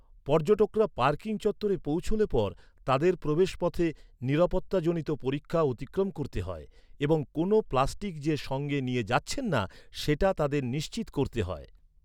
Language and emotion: Bengali, neutral